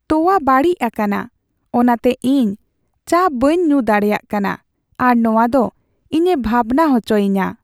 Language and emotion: Santali, sad